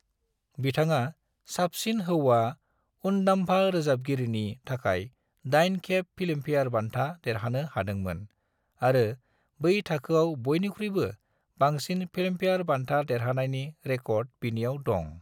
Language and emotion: Bodo, neutral